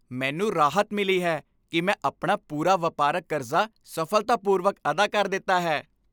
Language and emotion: Punjabi, happy